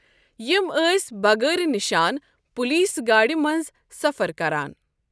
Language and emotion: Kashmiri, neutral